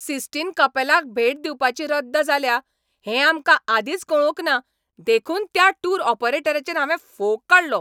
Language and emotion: Goan Konkani, angry